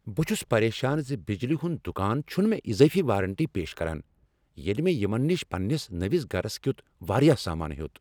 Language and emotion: Kashmiri, angry